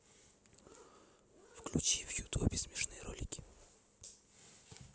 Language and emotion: Russian, neutral